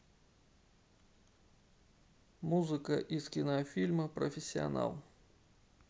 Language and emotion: Russian, neutral